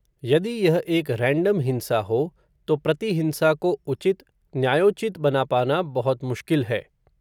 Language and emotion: Hindi, neutral